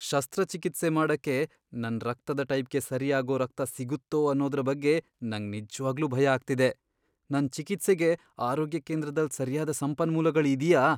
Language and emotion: Kannada, fearful